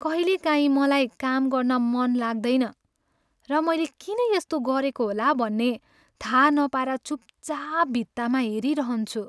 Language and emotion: Nepali, sad